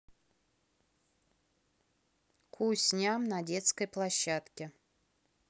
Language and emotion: Russian, neutral